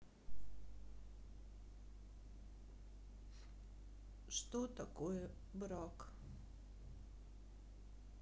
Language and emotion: Russian, sad